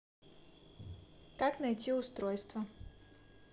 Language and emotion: Russian, neutral